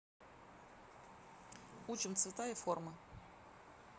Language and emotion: Russian, neutral